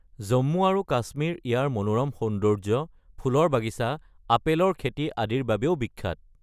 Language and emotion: Assamese, neutral